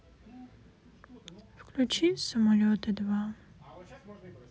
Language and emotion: Russian, sad